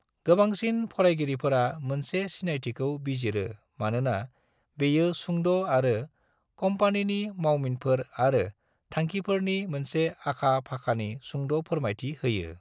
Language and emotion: Bodo, neutral